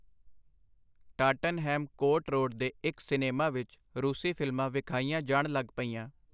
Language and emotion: Punjabi, neutral